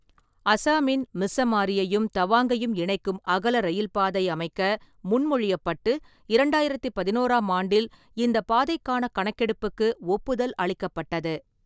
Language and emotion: Tamil, neutral